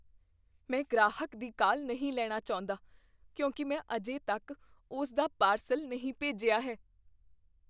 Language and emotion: Punjabi, fearful